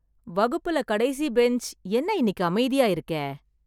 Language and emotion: Tamil, surprised